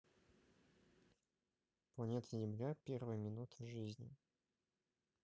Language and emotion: Russian, neutral